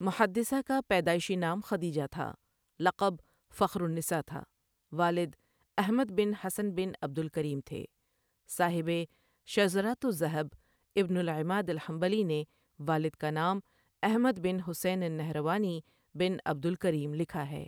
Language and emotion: Urdu, neutral